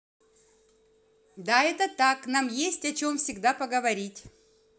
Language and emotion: Russian, neutral